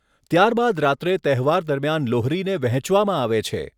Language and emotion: Gujarati, neutral